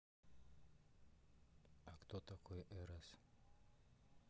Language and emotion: Russian, neutral